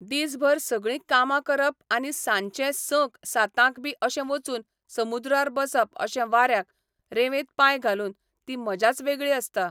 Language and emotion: Goan Konkani, neutral